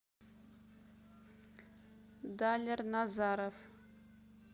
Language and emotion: Russian, neutral